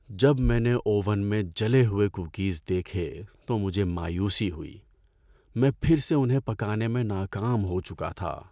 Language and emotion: Urdu, sad